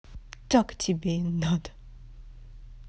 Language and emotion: Russian, angry